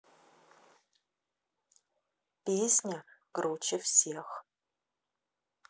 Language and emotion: Russian, neutral